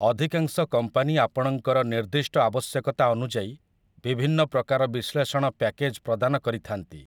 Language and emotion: Odia, neutral